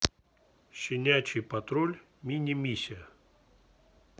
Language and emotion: Russian, neutral